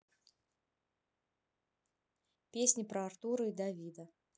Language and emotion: Russian, neutral